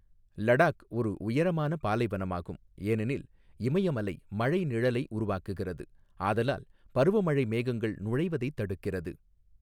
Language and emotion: Tamil, neutral